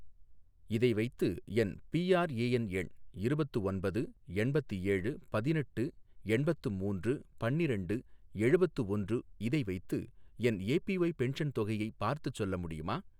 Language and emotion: Tamil, neutral